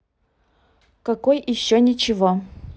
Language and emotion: Russian, neutral